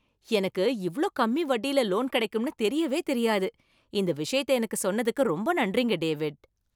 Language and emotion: Tamil, surprised